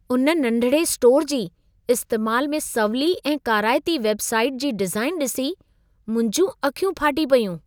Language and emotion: Sindhi, surprised